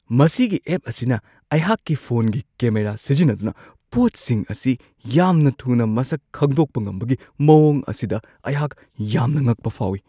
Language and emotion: Manipuri, surprised